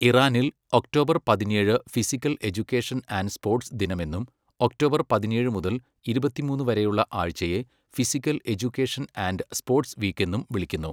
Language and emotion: Malayalam, neutral